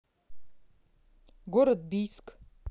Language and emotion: Russian, neutral